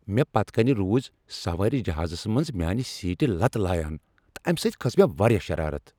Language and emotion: Kashmiri, angry